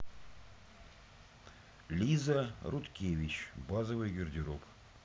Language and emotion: Russian, neutral